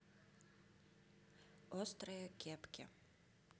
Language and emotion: Russian, neutral